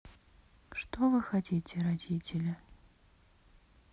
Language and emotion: Russian, sad